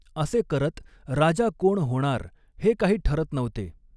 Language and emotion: Marathi, neutral